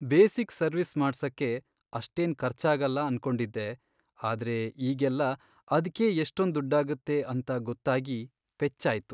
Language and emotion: Kannada, sad